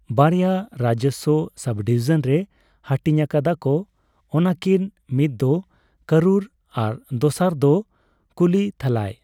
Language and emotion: Santali, neutral